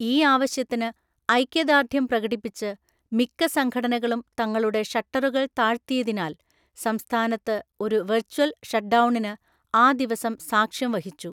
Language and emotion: Malayalam, neutral